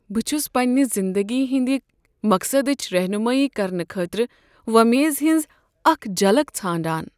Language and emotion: Kashmiri, sad